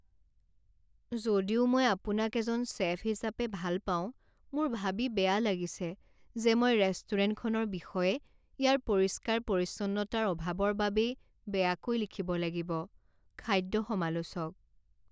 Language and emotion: Assamese, sad